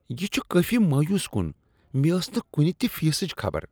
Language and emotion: Kashmiri, disgusted